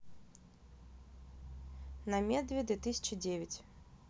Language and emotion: Russian, neutral